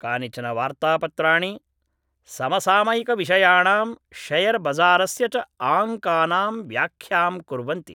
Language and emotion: Sanskrit, neutral